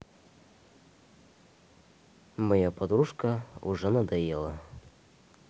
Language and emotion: Russian, neutral